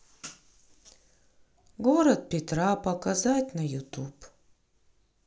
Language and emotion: Russian, sad